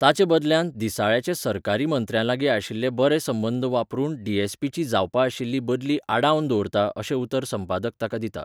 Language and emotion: Goan Konkani, neutral